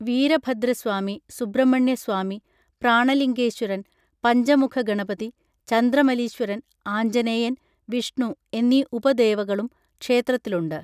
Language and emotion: Malayalam, neutral